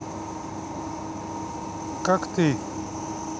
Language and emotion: Russian, neutral